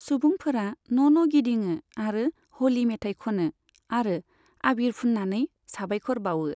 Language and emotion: Bodo, neutral